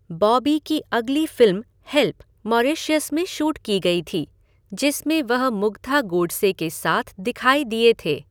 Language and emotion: Hindi, neutral